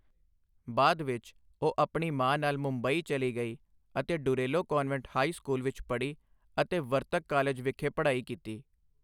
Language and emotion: Punjabi, neutral